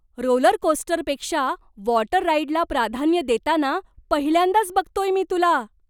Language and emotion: Marathi, surprised